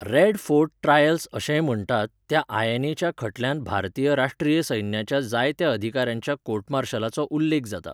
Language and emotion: Goan Konkani, neutral